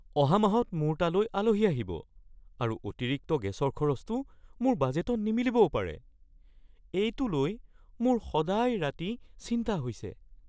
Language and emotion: Assamese, fearful